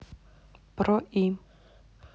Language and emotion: Russian, neutral